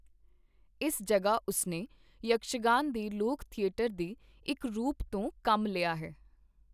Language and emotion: Punjabi, neutral